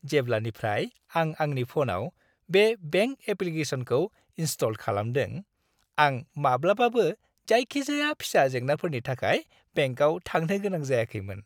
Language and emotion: Bodo, happy